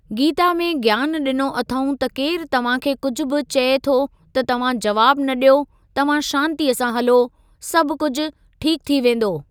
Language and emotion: Sindhi, neutral